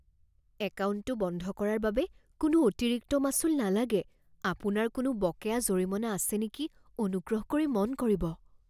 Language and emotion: Assamese, fearful